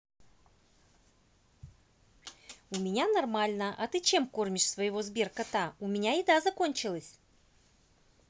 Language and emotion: Russian, positive